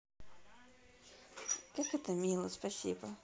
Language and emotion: Russian, neutral